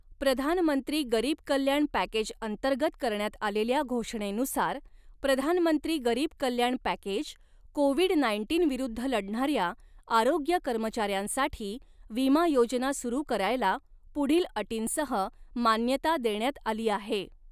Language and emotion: Marathi, neutral